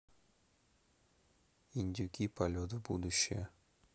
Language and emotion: Russian, neutral